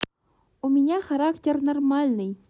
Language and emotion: Russian, neutral